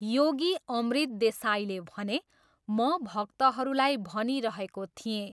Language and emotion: Nepali, neutral